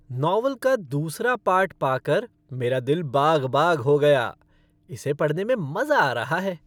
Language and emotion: Hindi, happy